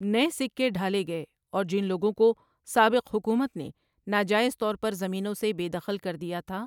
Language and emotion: Urdu, neutral